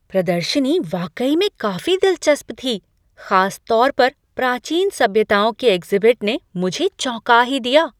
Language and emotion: Hindi, surprised